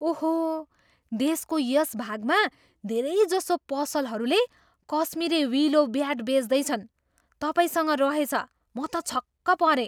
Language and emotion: Nepali, surprised